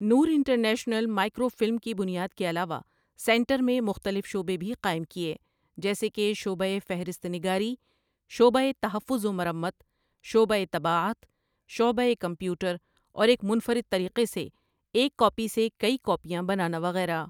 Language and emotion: Urdu, neutral